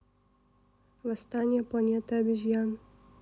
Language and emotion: Russian, neutral